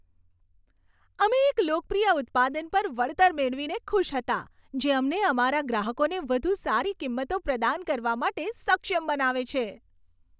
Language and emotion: Gujarati, happy